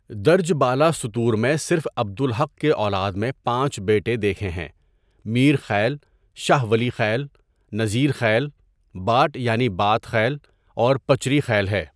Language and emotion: Urdu, neutral